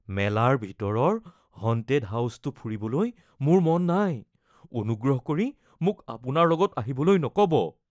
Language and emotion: Assamese, fearful